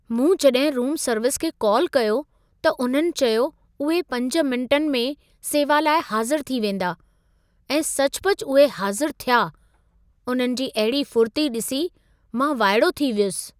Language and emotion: Sindhi, surprised